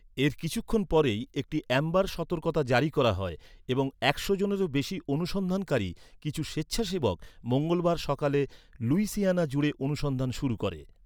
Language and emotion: Bengali, neutral